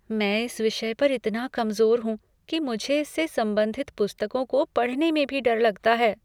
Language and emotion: Hindi, fearful